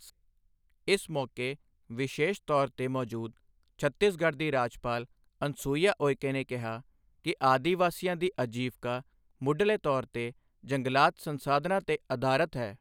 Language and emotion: Punjabi, neutral